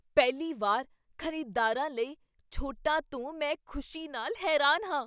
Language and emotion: Punjabi, surprised